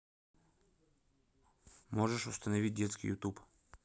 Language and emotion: Russian, neutral